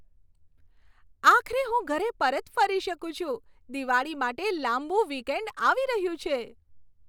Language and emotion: Gujarati, happy